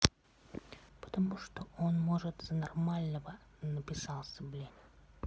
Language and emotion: Russian, neutral